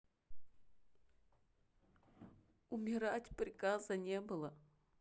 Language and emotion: Russian, sad